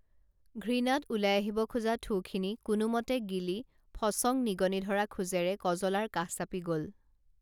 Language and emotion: Assamese, neutral